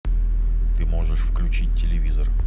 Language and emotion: Russian, neutral